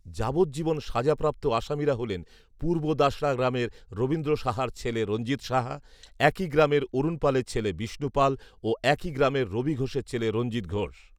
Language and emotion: Bengali, neutral